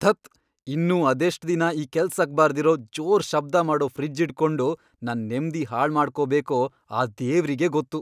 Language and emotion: Kannada, angry